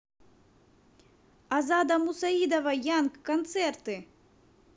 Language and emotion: Russian, neutral